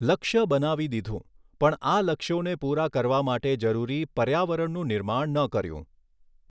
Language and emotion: Gujarati, neutral